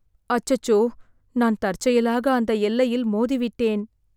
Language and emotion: Tamil, sad